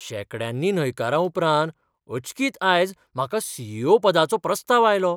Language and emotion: Goan Konkani, surprised